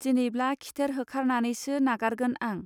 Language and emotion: Bodo, neutral